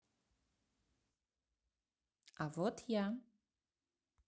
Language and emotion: Russian, neutral